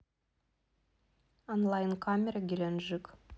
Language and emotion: Russian, neutral